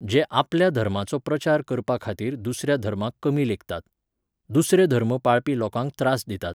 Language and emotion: Goan Konkani, neutral